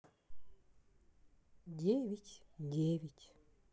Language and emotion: Russian, sad